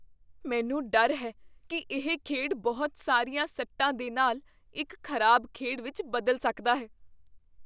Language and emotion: Punjabi, fearful